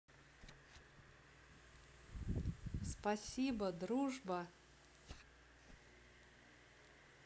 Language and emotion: Russian, positive